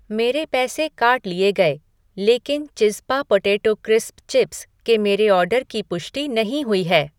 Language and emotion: Hindi, neutral